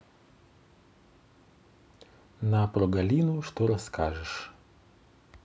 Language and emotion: Russian, neutral